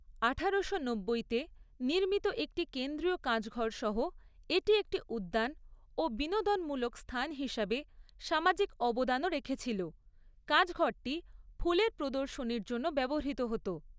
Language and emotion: Bengali, neutral